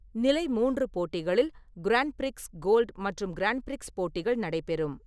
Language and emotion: Tamil, neutral